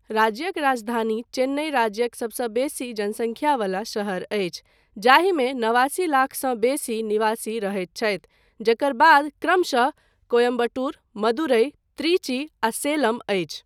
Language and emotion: Maithili, neutral